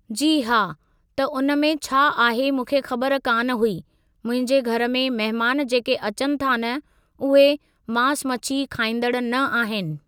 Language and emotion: Sindhi, neutral